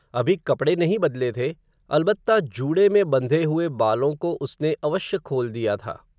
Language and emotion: Hindi, neutral